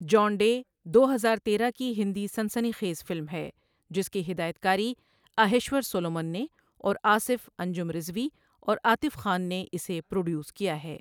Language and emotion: Urdu, neutral